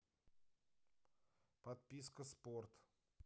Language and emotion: Russian, neutral